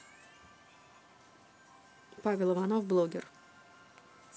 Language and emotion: Russian, neutral